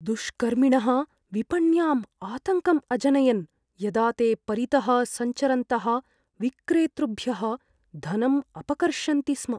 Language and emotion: Sanskrit, fearful